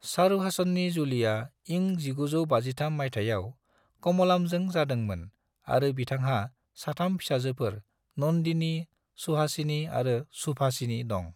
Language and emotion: Bodo, neutral